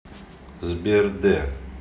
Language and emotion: Russian, neutral